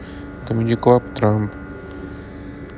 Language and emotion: Russian, neutral